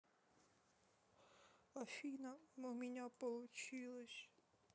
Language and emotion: Russian, sad